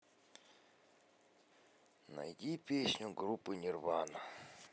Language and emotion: Russian, neutral